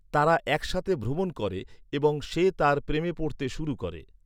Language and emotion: Bengali, neutral